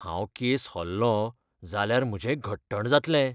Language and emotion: Goan Konkani, fearful